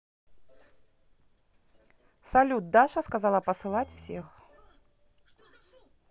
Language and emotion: Russian, neutral